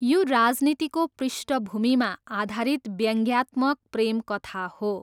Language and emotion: Nepali, neutral